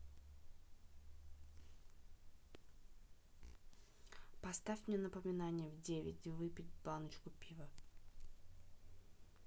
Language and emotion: Russian, neutral